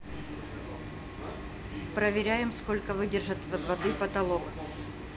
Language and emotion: Russian, neutral